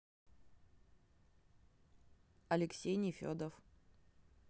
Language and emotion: Russian, neutral